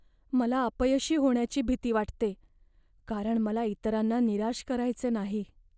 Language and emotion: Marathi, fearful